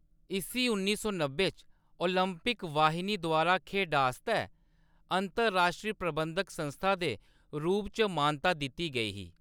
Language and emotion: Dogri, neutral